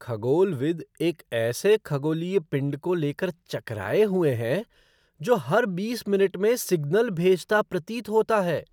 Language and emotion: Hindi, surprised